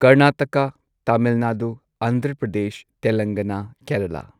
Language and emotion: Manipuri, neutral